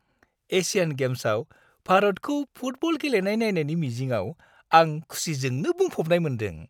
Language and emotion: Bodo, happy